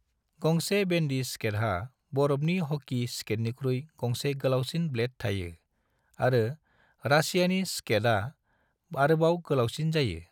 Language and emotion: Bodo, neutral